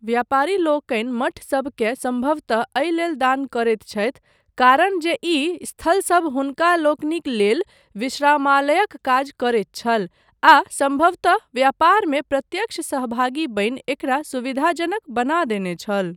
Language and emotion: Maithili, neutral